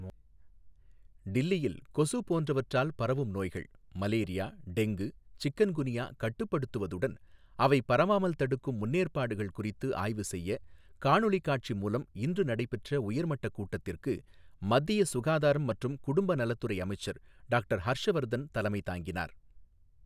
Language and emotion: Tamil, neutral